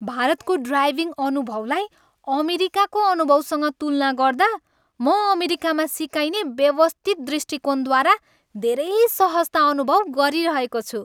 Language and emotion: Nepali, happy